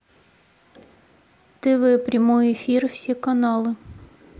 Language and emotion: Russian, neutral